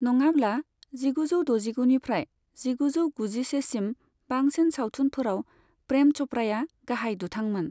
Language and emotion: Bodo, neutral